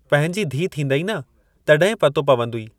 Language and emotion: Sindhi, neutral